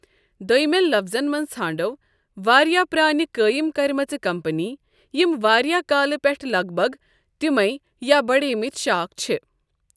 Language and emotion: Kashmiri, neutral